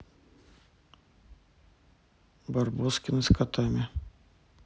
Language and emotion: Russian, neutral